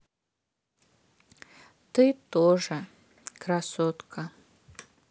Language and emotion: Russian, sad